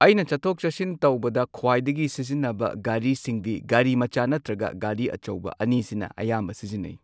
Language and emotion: Manipuri, neutral